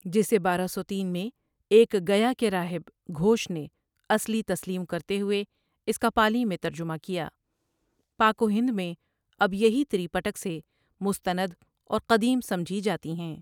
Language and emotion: Urdu, neutral